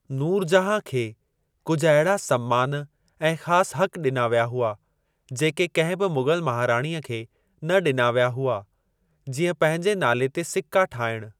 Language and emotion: Sindhi, neutral